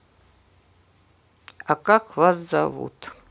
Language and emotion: Russian, neutral